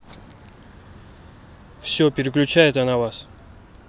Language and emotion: Russian, neutral